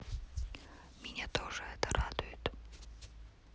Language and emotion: Russian, neutral